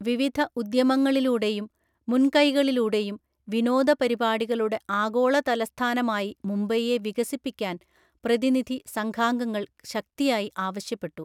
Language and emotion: Malayalam, neutral